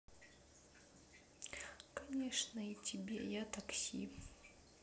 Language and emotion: Russian, neutral